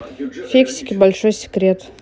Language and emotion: Russian, neutral